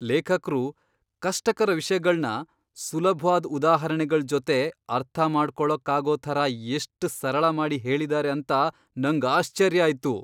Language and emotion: Kannada, surprised